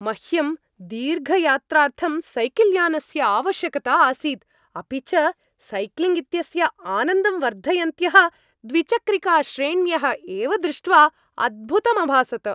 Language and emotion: Sanskrit, happy